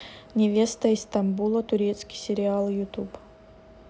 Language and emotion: Russian, neutral